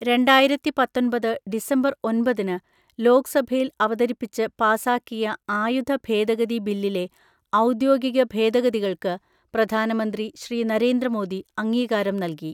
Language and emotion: Malayalam, neutral